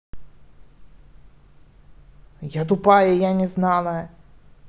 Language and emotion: Russian, angry